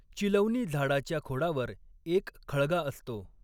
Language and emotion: Marathi, neutral